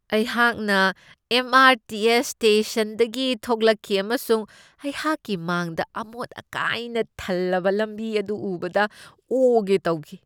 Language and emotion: Manipuri, disgusted